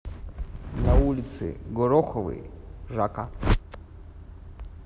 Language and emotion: Russian, neutral